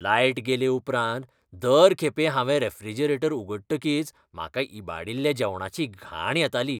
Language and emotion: Goan Konkani, disgusted